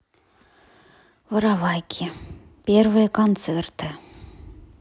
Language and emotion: Russian, sad